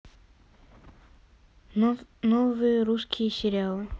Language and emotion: Russian, neutral